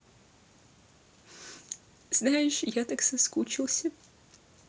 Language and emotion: Russian, sad